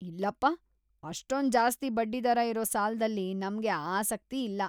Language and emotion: Kannada, disgusted